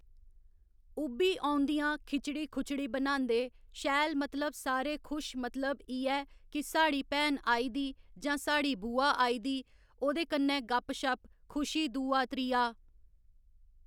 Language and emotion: Dogri, neutral